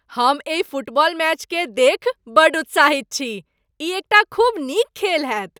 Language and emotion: Maithili, happy